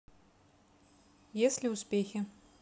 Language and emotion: Russian, neutral